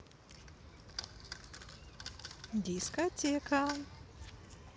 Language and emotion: Russian, positive